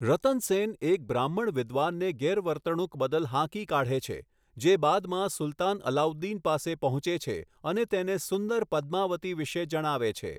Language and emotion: Gujarati, neutral